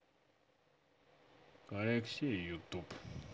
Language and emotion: Russian, neutral